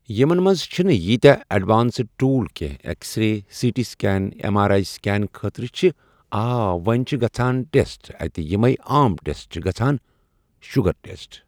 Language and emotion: Kashmiri, neutral